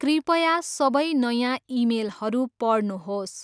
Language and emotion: Nepali, neutral